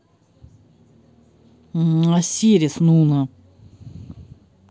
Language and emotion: Russian, neutral